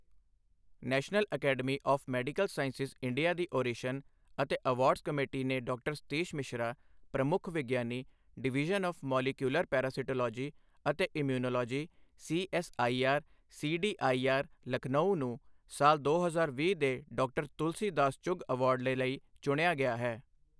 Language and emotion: Punjabi, neutral